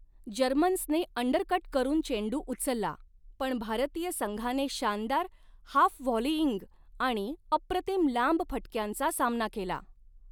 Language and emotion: Marathi, neutral